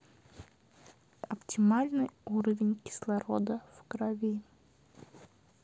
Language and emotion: Russian, neutral